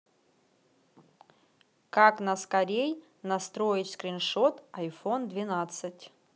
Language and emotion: Russian, neutral